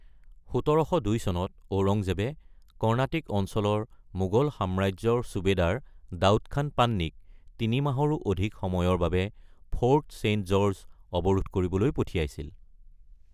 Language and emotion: Assamese, neutral